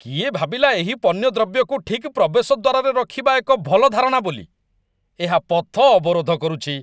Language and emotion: Odia, disgusted